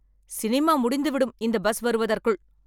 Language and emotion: Tamil, angry